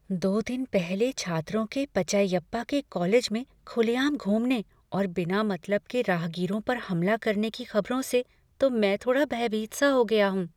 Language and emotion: Hindi, fearful